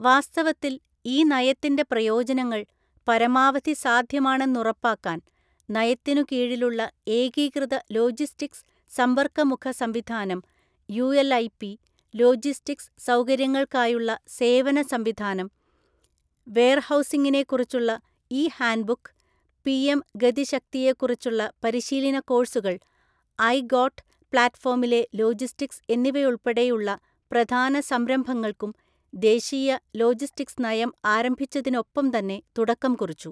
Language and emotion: Malayalam, neutral